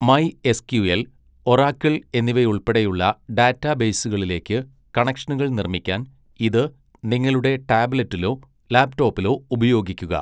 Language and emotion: Malayalam, neutral